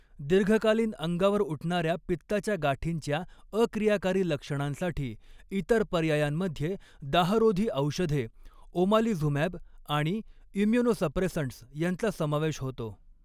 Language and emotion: Marathi, neutral